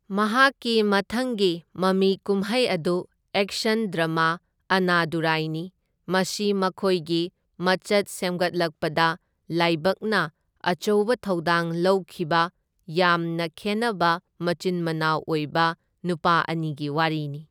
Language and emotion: Manipuri, neutral